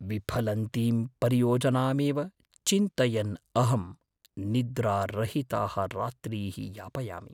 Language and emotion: Sanskrit, fearful